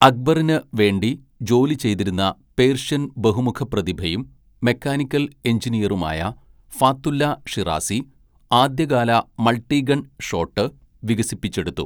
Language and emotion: Malayalam, neutral